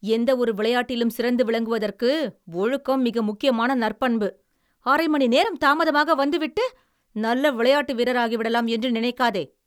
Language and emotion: Tamil, angry